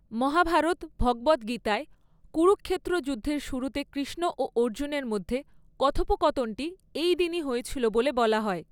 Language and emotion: Bengali, neutral